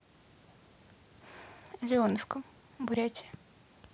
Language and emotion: Russian, neutral